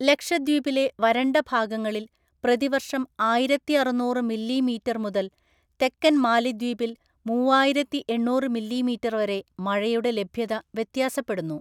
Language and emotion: Malayalam, neutral